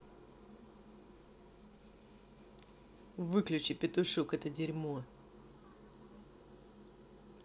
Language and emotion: Russian, angry